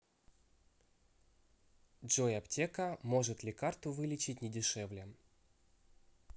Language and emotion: Russian, neutral